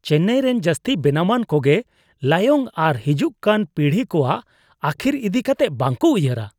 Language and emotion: Santali, disgusted